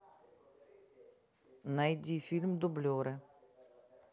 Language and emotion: Russian, neutral